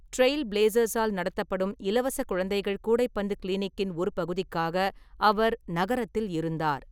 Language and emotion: Tamil, neutral